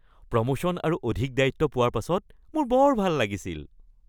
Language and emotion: Assamese, happy